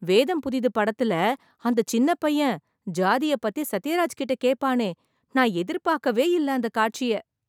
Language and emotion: Tamil, surprised